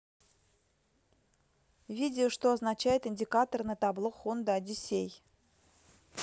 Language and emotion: Russian, neutral